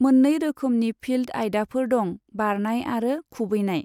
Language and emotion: Bodo, neutral